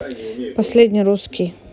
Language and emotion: Russian, neutral